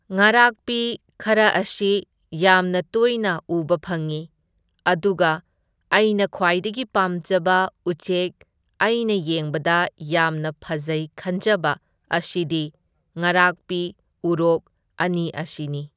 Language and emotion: Manipuri, neutral